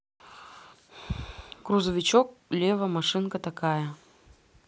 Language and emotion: Russian, neutral